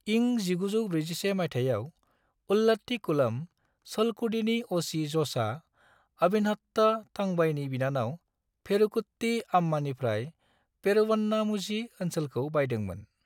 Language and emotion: Bodo, neutral